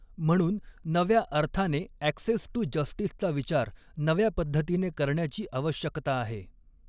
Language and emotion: Marathi, neutral